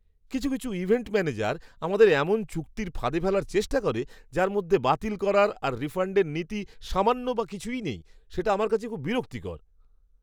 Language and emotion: Bengali, disgusted